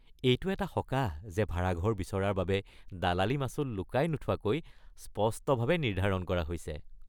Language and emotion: Assamese, happy